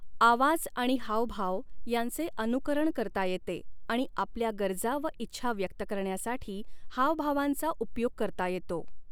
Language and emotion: Marathi, neutral